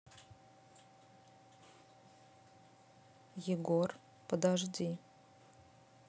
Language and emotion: Russian, neutral